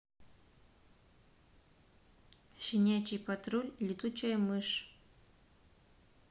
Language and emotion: Russian, neutral